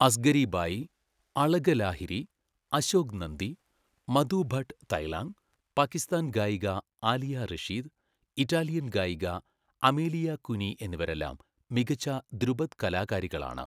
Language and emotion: Malayalam, neutral